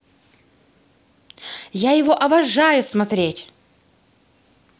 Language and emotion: Russian, positive